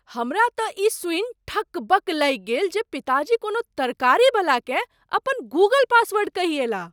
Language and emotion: Maithili, surprised